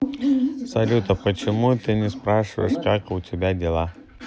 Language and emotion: Russian, neutral